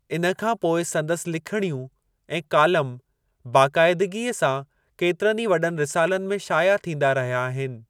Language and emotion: Sindhi, neutral